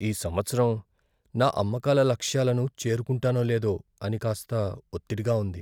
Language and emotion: Telugu, fearful